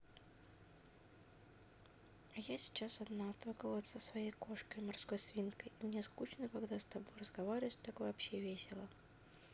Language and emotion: Russian, sad